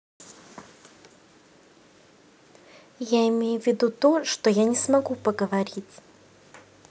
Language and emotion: Russian, neutral